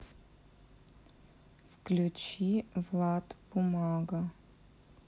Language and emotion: Russian, sad